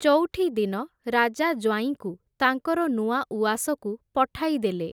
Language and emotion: Odia, neutral